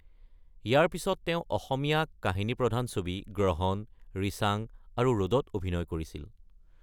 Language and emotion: Assamese, neutral